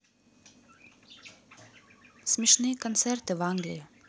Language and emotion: Russian, neutral